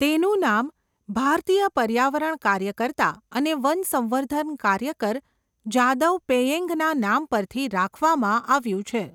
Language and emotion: Gujarati, neutral